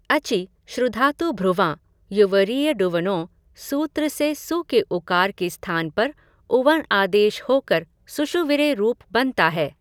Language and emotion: Hindi, neutral